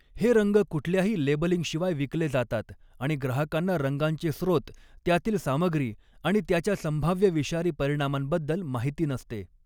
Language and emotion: Marathi, neutral